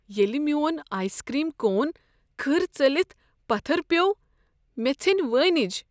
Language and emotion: Kashmiri, sad